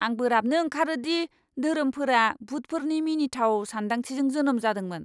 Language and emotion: Bodo, angry